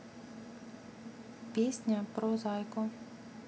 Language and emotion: Russian, neutral